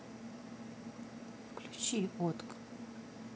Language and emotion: Russian, neutral